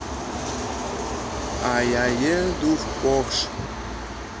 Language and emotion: Russian, neutral